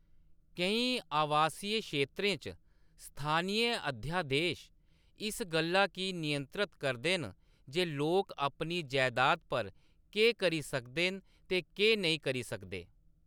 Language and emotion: Dogri, neutral